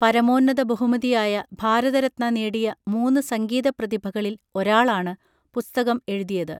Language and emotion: Malayalam, neutral